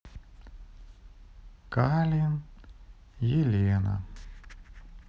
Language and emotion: Russian, sad